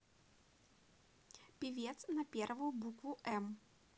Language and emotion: Russian, positive